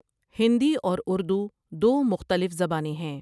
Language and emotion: Urdu, neutral